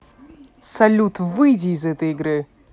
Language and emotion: Russian, angry